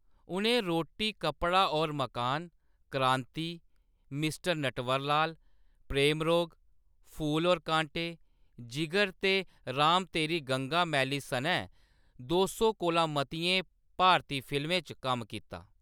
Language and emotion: Dogri, neutral